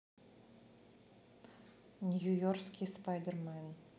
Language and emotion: Russian, neutral